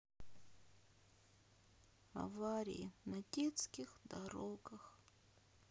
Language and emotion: Russian, sad